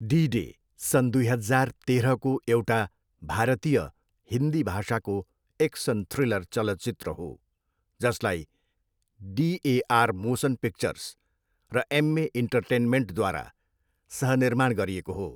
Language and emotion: Nepali, neutral